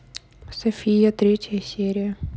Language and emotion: Russian, neutral